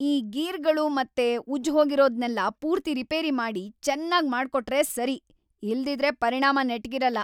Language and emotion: Kannada, angry